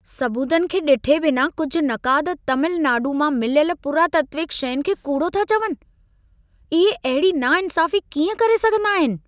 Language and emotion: Sindhi, angry